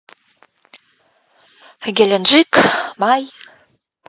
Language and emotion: Russian, neutral